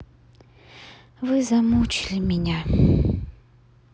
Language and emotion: Russian, sad